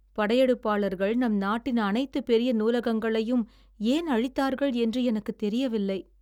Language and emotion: Tamil, sad